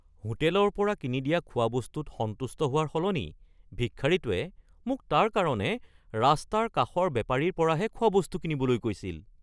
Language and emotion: Assamese, surprised